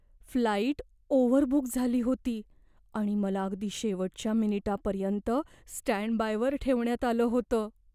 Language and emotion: Marathi, fearful